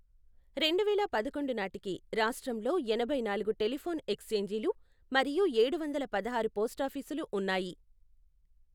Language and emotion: Telugu, neutral